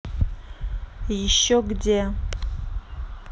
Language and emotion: Russian, neutral